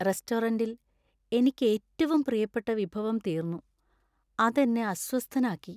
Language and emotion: Malayalam, sad